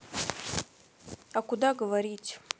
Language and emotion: Russian, neutral